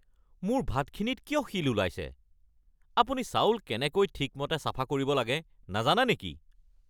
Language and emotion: Assamese, angry